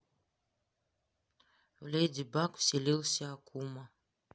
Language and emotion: Russian, neutral